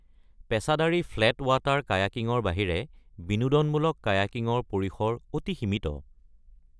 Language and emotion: Assamese, neutral